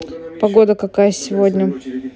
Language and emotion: Russian, neutral